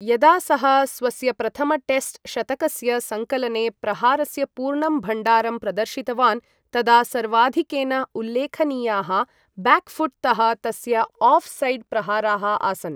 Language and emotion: Sanskrit, neutral